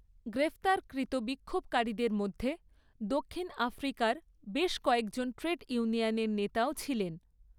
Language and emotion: Bengali, neutral